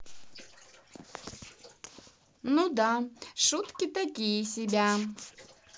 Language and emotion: Russian, neutral